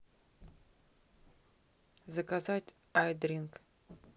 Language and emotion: Russian, neutral